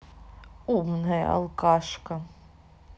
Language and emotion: Russian, neutral